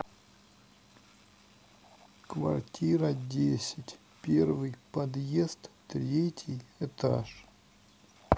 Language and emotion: Russian, neutral